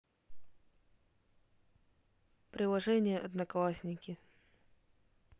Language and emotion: Russian, neutral